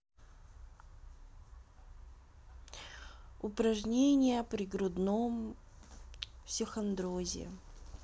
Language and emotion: Russian, neutral